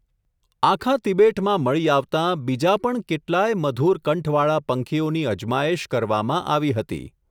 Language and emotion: Gujarati, neutral